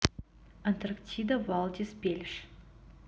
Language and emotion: Russian, neutral